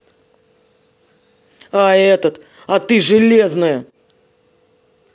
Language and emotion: Russian, angry